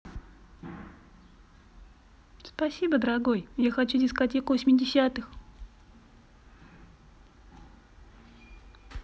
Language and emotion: Russian, positive